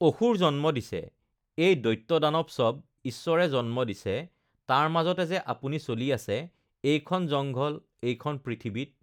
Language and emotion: Assamese, neutral